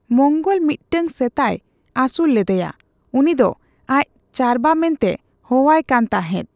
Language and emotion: Santali, neutral